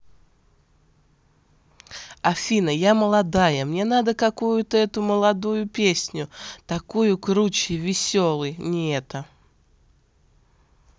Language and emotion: Russian, positive